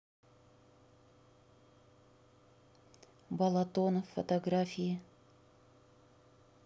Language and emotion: Russian, neutral